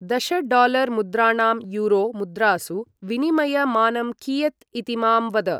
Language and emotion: Sanskrit, neutral